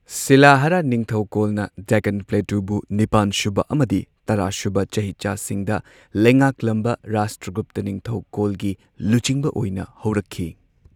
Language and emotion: Manipuri, neutral